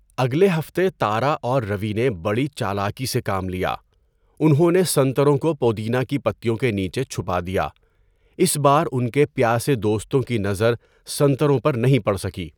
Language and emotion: Urdu, neutral